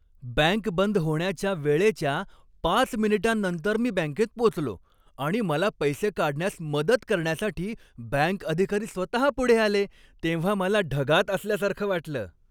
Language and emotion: Marathi, happy